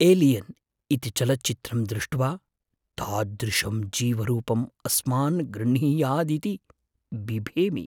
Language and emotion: Sanskrit, fearful